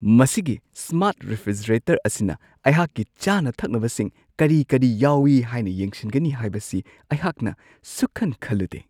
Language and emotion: Manipuri, surprised